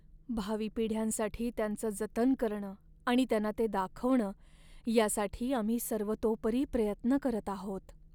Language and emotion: Marathi, sad